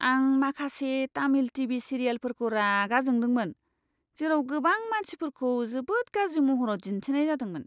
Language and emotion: Bodo, disgusted